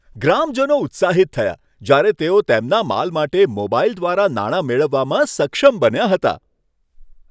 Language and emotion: Gujarati, happy